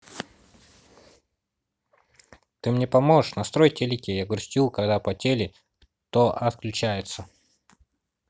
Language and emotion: Russian, neutral